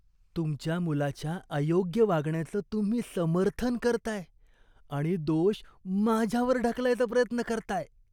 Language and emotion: Marathi, disgusted